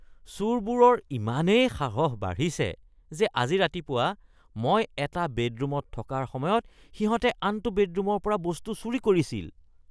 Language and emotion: Assamese, disgusted